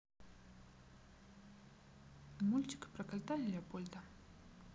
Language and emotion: Russian, neutral